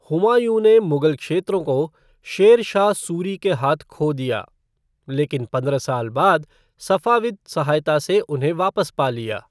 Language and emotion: Hindi, neutral